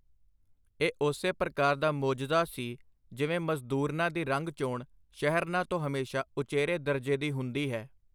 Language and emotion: Punjabi, neutral